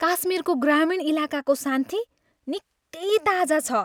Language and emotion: Nepali, happy